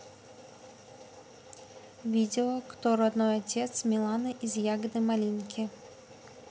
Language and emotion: Russian, neutral